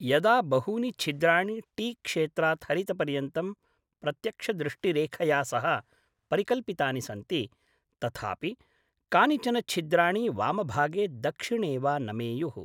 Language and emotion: Sanskrit, neutral